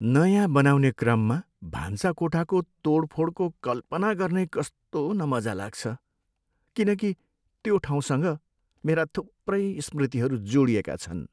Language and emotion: Nepali, sad